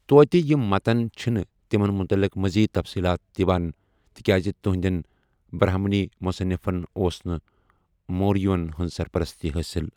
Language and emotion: Kashmiri, neutral